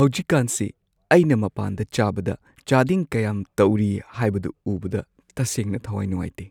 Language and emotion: Manipuri, sad